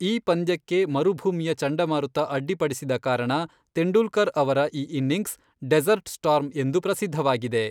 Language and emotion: Kannada, neutral